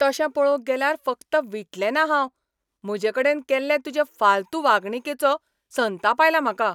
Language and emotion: Goan Konkani, angry